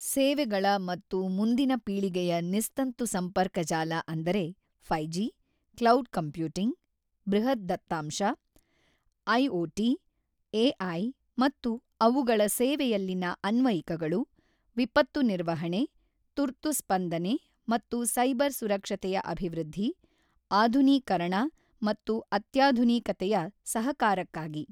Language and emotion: Kannada, neutral